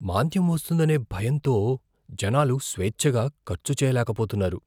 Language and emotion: Telugu, fearful